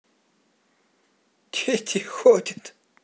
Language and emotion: Russian, positive